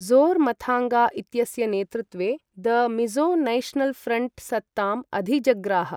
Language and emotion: Sanskrit, neutral